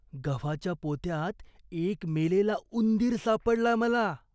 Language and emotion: Marathi, disgusted